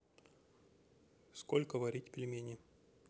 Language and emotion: Russian, neutral